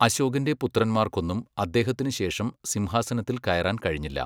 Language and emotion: Malayalam, neutral